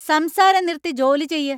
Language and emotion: Malayalam, angry